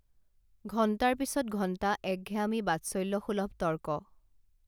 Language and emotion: Assamese, neutral